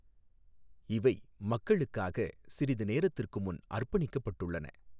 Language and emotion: Tamil, neutral